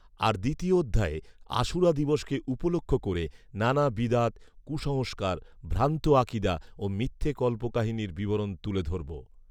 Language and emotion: Bengali, neutral